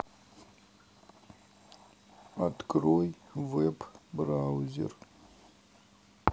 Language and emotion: Russian, neutral